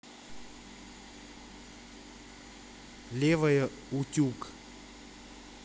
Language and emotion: Russian, neutral